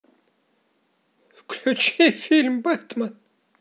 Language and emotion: Russian, positive